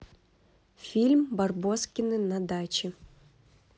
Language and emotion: Russian, neutral